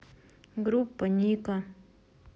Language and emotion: Russian, neutral